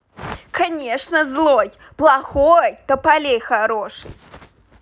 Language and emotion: Russian, angry